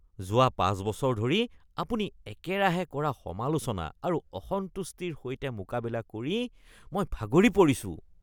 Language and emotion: Assamese, disgusted